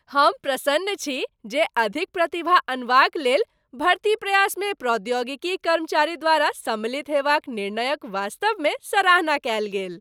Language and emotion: Maithili, happy